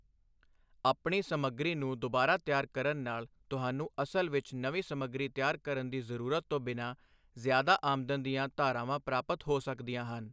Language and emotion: Punjabi, neutral